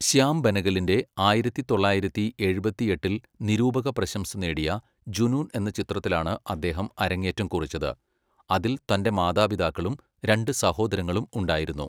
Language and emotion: Malayalam, neutral